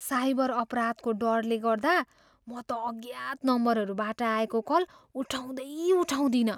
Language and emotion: Nepali, fearful